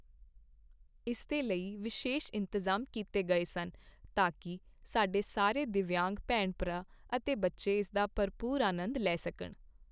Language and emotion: Punjabi, neutral